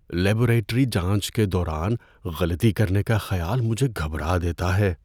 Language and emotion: Urdu, fearful